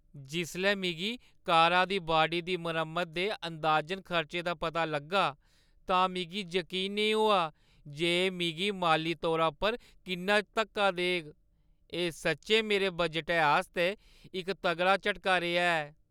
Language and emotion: Dogri, sad